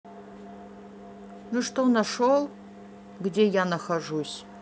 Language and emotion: Russian, neutral